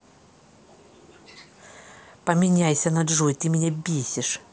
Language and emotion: Russian, angry